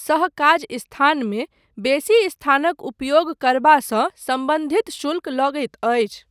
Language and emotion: Maithili, neutral